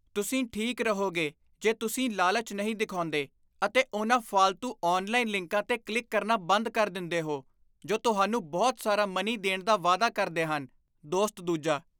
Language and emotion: Punjabi, disgusted